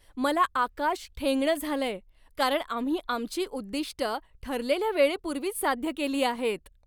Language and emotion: Marathi, happy